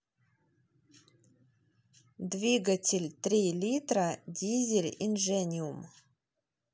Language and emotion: Russian, neutral